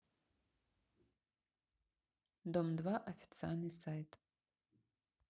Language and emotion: Russian, neutral